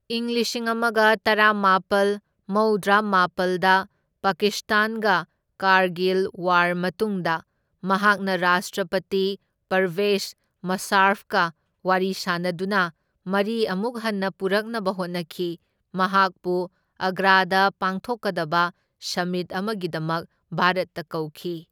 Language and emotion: Manipuri, neutral